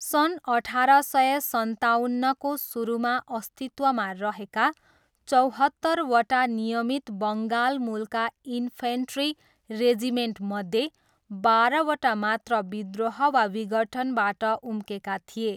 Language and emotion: Nepali, neutral